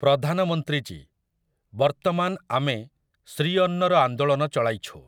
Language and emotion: Odia, neutral